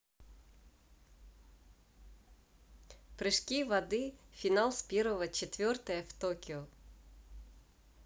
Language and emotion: Russian, neutral